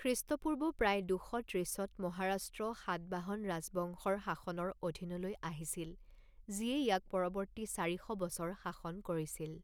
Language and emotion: Assamese, neutral